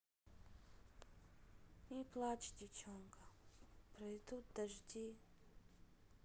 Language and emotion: Russian, sad